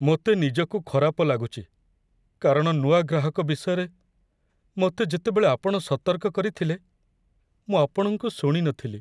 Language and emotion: Odia, sad